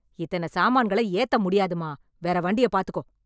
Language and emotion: Tamil, angry